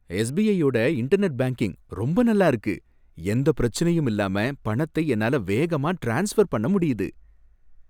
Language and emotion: Tamil, happy